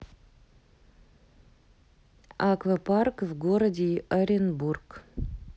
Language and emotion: Russian, neutral